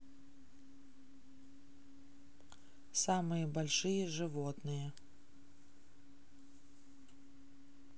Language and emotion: Russian, neutral